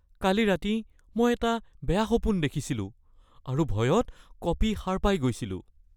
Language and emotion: Assamese, fearful